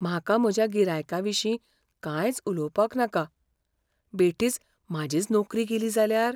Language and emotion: Goan Konkani, fearful